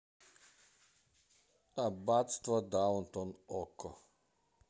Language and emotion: Russian, neutral